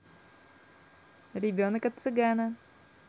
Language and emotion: Russian, positive